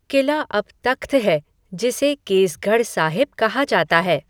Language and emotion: Hindi, neutral